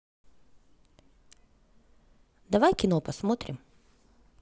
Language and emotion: Russian, positive